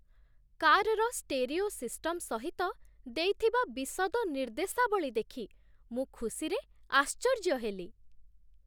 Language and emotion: Odia, surprised